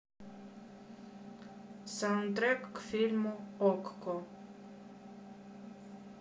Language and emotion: Russian, neutral